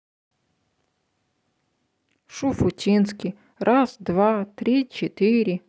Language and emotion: Russian, neutral